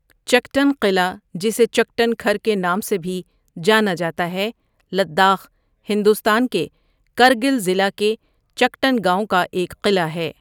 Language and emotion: Urdu, neutral